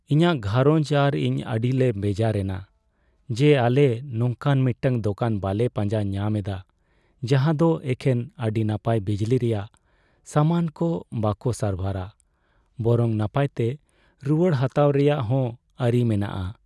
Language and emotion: Santali, sad